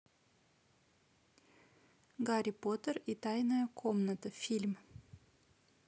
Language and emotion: Russian, neutral